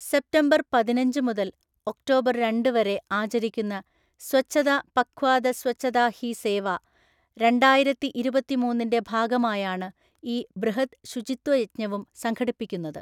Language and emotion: Malayalam, neutral